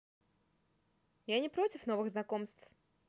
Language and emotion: Russian, positive